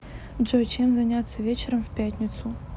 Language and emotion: Russian, neutral